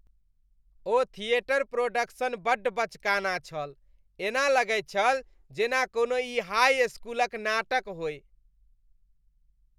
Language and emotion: Maithili, disgusted